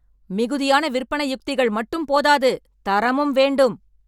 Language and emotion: Tamil, angry